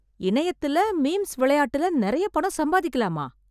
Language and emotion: Tamil, surprised